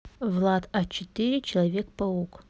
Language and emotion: Russian, neutral